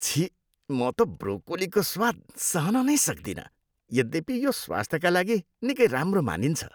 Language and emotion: Nepali, disgusted